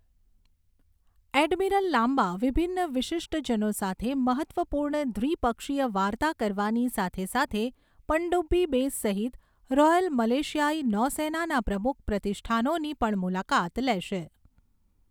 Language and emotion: Gujarati, neutral